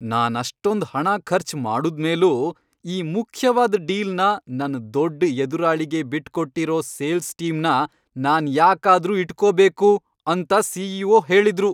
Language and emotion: Kannada, angry